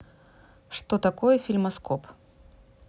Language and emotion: Russian, neutral